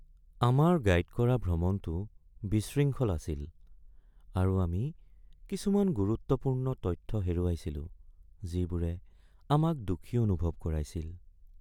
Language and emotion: Assamese, sad